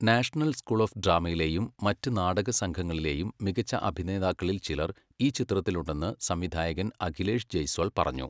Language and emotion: Malayalam, neutral